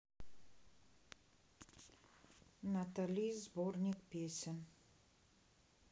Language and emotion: Russian, neutral